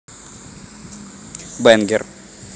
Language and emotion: Russian, neutral